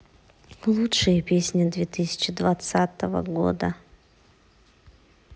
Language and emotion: Russian, neutral